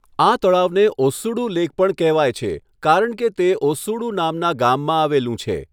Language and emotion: Gujarati, neutral